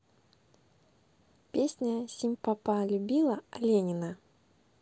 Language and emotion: Russian, neutral